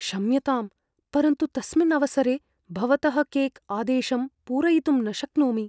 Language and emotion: Sanskrit, fearful